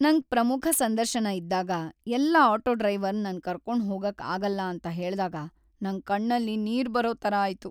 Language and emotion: Kannada, sad